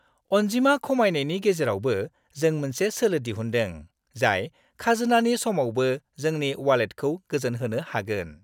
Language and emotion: Bodo, happy